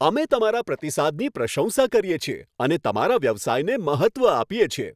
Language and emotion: Gujarati, happy